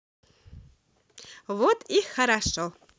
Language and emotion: Russian, positive